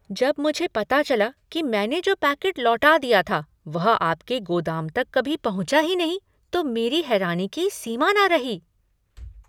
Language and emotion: Hindi, surprised